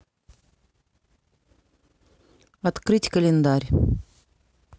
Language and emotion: Russian, neutral